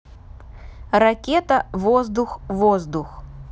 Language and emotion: Russian, neutral